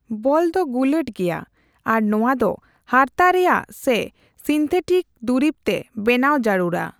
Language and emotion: Santali, neutral